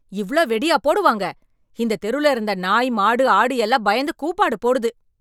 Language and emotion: Tamil, angry